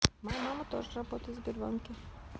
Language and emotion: Russian, neutral